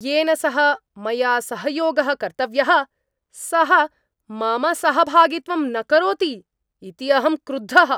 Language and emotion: Sanskrit, angry